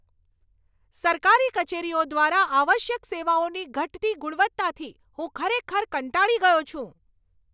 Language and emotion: Gujarati, angry